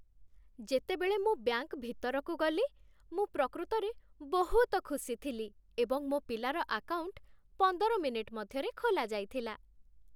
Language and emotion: Odia, happy